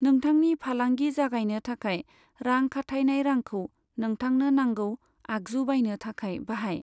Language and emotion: Bodo, neutral